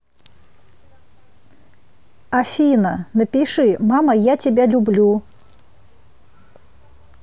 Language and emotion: Russian, neutral